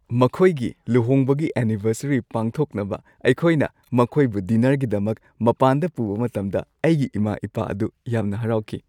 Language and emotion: Manipuri, happy